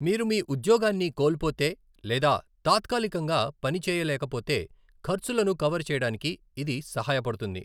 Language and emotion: Telugu, neutral